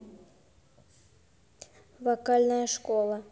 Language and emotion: Russian, neutral